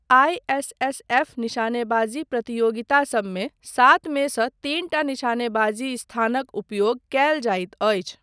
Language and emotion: Maithili, neutral